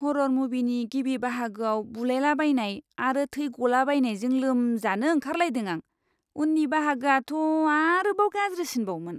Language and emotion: Bodo, disgusted